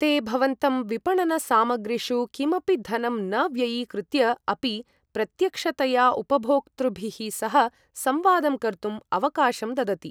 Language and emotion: Sanskrit, neutral